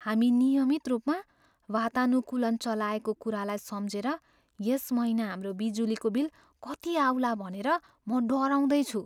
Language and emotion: Nepali, fearful